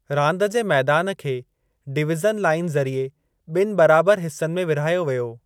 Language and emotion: Sindhi, neutral